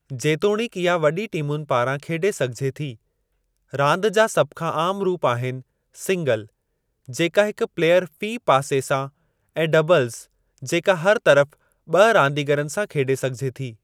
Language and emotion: Sindhi, neutral